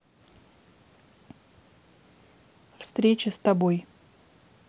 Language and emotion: Russian, neutral